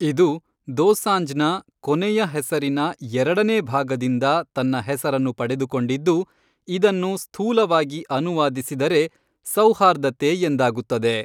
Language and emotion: Kannada, neutral